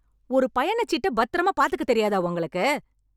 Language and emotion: Tamil, angry